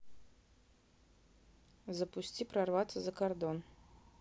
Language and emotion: Russian, neutral